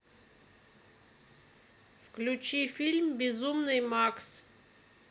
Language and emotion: Russian, neutral